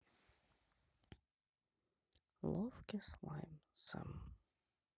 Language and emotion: Russian, neutral